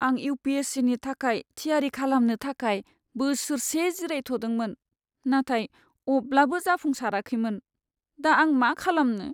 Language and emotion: Bodo, sad